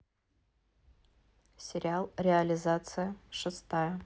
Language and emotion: Russian, neutral